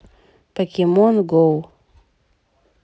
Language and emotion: Russian, neutral